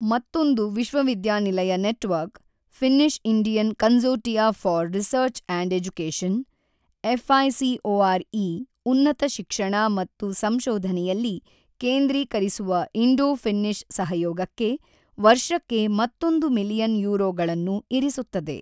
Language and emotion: Kannada, neutral